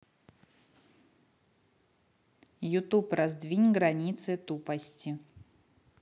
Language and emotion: Russian, neutral